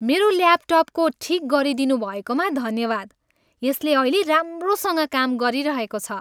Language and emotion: Nepali, happy